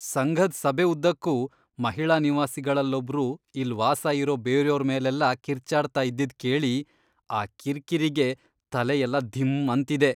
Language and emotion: Kannada, disgusted